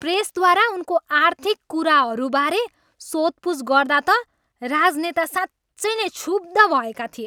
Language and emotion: Nepali, angry